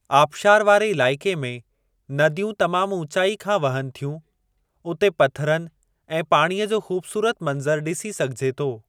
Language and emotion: Sindhi, neutral